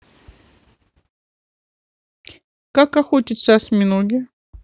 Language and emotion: Russian, neutral